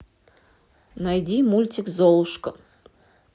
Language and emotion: Russian, neutral